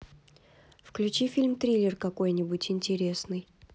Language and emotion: Russian, neutral